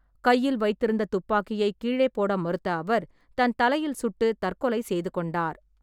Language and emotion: Tamil, neutral